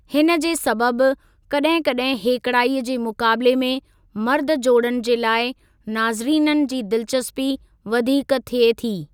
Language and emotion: Sindhi, neutral